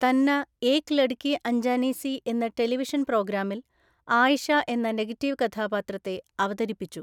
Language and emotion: Malayalam, neutral